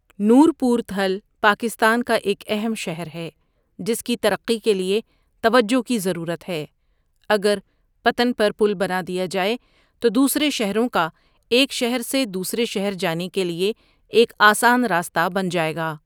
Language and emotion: Urdu, neutral